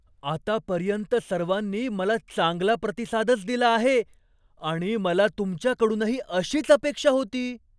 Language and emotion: Marathi, surprised